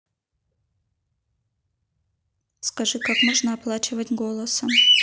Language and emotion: Russian, neutral